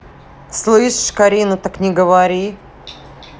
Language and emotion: Russian, angry